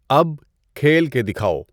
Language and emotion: Urdu, neutral